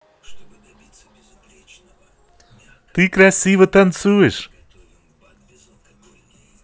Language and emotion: Russian, positive